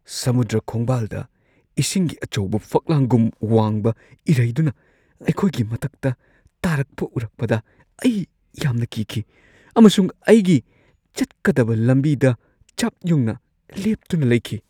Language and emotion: Manipuri, fearful